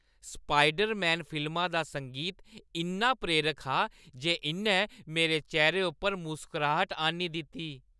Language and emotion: Dogri, happy